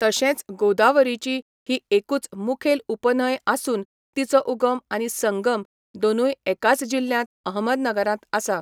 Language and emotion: Goan Konkani, neutral